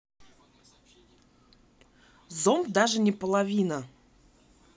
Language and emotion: Russian, neutral